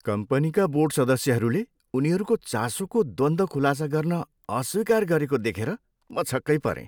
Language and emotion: Nepali, disgusted